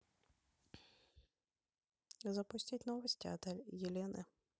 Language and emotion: Russian, neutral